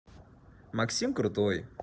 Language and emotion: Russian, positive